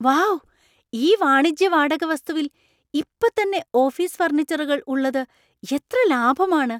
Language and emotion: Malayalam, surprised